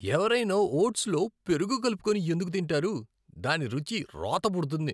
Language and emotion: Telugu, disgusted